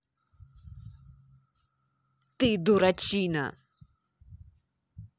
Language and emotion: Russian, angry